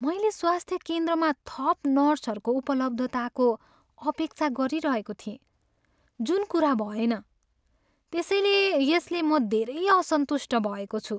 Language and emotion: Nepali, sad